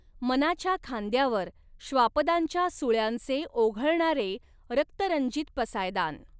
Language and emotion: Marathi, neutral